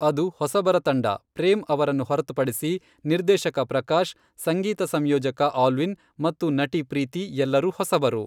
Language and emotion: Kannada, neutral